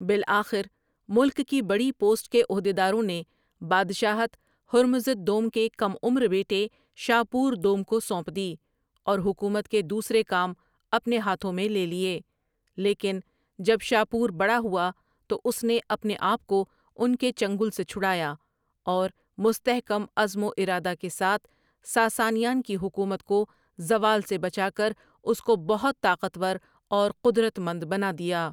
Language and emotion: Urdu, neutral